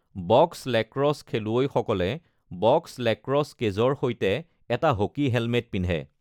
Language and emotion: Assamese, neutral